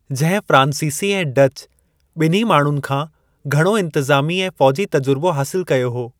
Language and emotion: Sindhi, neutral